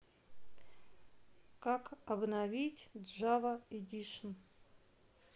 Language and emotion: Russian, neutral